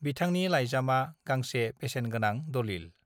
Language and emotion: Bodo, neutral